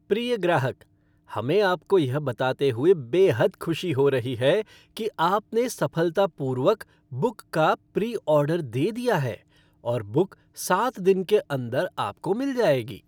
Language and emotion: Hindi, happy